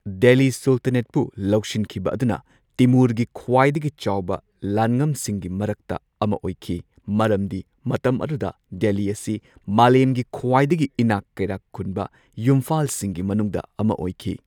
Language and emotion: Manipuri, neutral